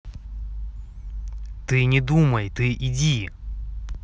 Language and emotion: Russian, angry